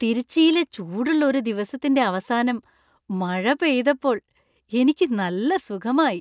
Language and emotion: Malayalam, happy